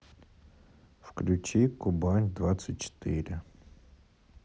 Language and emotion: Russian, sad